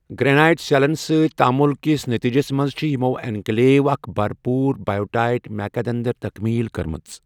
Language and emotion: Kashmiri, neutral